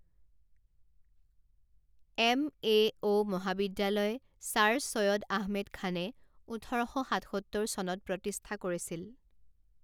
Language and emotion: Assamese, neutral